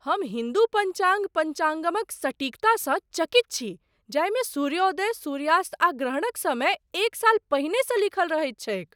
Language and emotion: Maithili, surprised